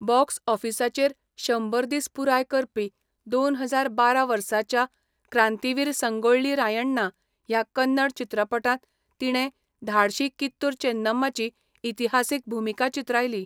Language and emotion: Goan Konkani, neutral